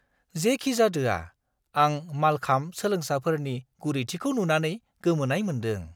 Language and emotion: Bodo, surprised